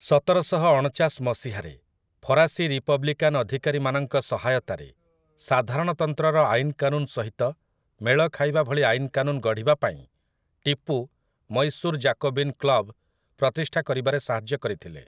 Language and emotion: Odia, neutral